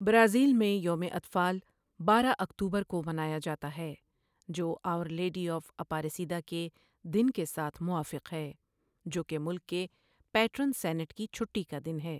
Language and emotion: Urdu, neutral